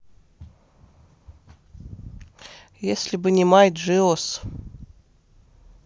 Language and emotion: Russian, neutral